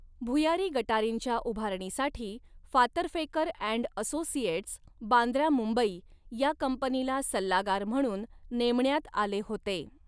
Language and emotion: Marathi, neutral